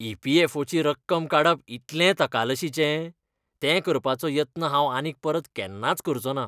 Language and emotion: Goan Konkani, disgusted